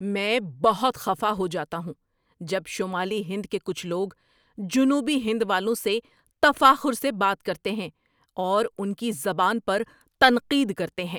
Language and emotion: Urdu, angry